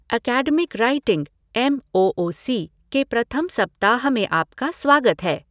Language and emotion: Hindi, neutral